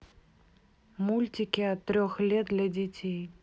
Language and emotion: Russian, neutral